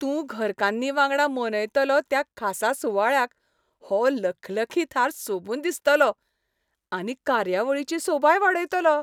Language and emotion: Goan Konkani, happy